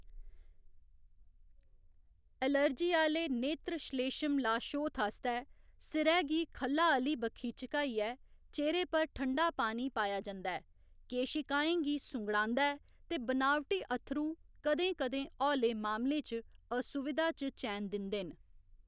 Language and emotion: Dogri, neutral